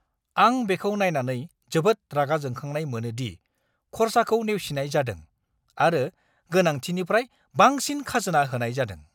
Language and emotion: Bodo, angry